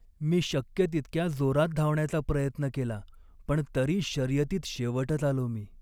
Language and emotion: Marathi, sad